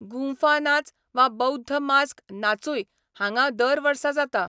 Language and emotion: Goan Konkani, neutral